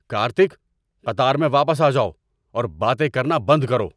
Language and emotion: Urdu, angry